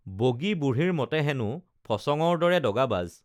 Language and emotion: Assamese, neutral